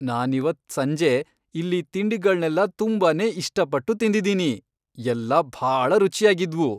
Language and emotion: Kannada, happy